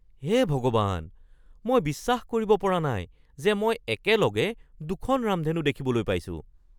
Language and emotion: Assamese, surprised